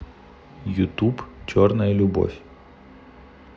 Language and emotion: Russian, neutral